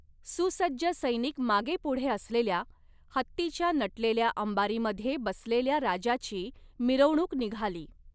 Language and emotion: Marathi, neutral